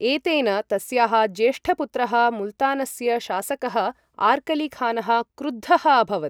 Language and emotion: Sanskrit, neutral